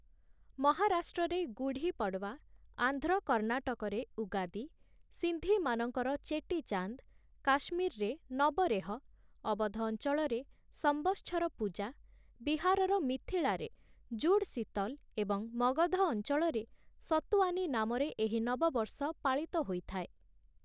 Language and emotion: Odia, neutral